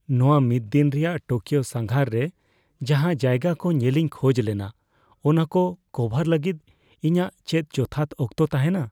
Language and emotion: Santali, fearful